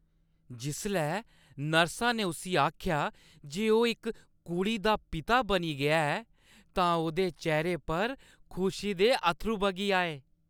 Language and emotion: Dogri, happy